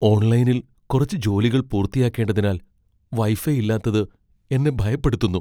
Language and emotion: Malayalam, fearful